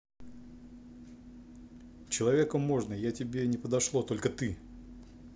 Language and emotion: Russian, neutral